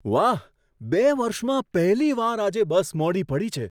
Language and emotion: Gujarati, surprised